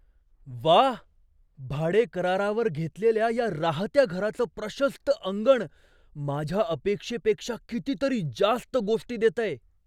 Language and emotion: Marathi, surprised